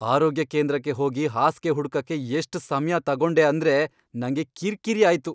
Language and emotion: Kannada, angry